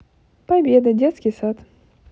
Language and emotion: Russian, positive